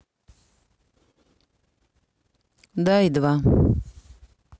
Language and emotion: Russian, neutral